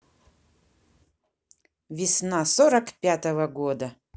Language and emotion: Russian, positive